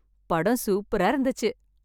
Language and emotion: Tamil, happy